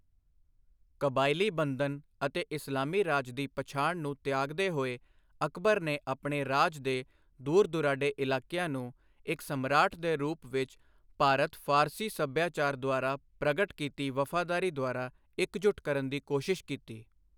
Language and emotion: Punjabi, neutral